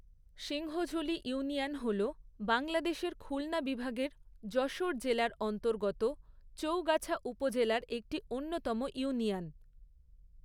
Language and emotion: Bengali, neutral